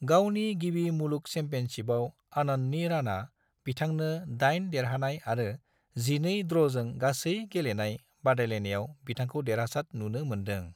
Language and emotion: Bodo, neutral